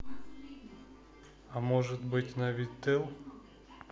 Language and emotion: Russian, neutral